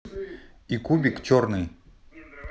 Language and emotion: Russian, neutral